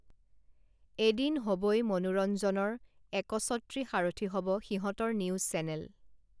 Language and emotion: Assamese, neutral